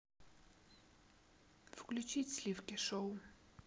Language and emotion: Russian, neutral